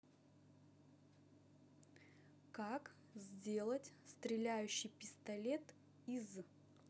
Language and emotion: Russian, neutral